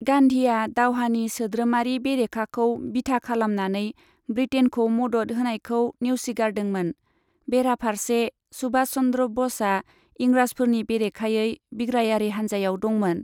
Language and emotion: Bodo, neutral